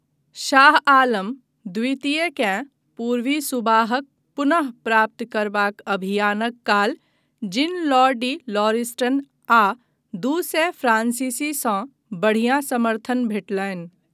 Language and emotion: Maithili, neutral